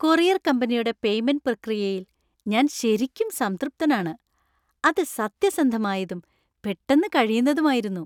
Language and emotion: Malayalam, happy